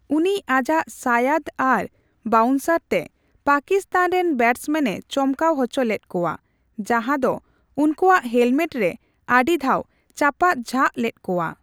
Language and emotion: Santali, neutral